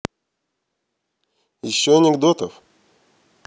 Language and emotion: Russian, neutral